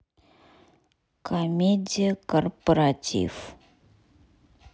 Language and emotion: Russian, neutral